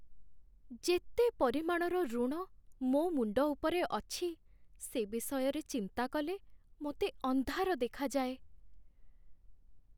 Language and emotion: Odia, sad